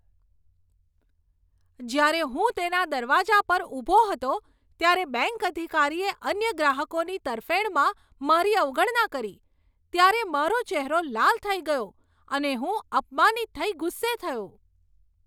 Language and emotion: Gujarati, angry